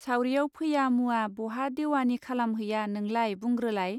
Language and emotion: Bodo, neutral